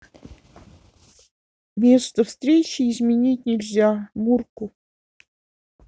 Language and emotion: Russian, sad